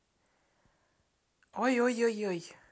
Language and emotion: Russian, neutral